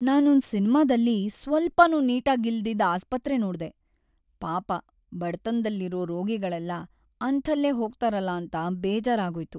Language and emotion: Kannada, sad